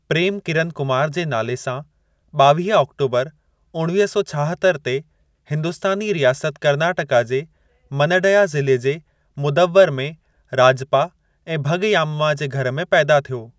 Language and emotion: Sindhi, neutral